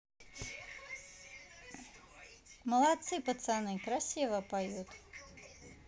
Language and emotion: Russian, positive